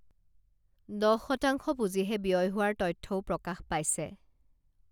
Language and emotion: Assamese, neutral